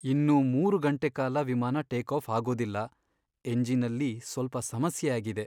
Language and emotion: Kannada, sad